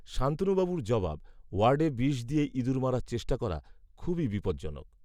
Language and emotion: Bengali, neutral